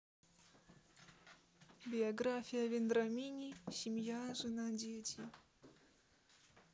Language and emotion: Russian, neutral